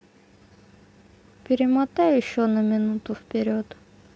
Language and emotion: Russian, sad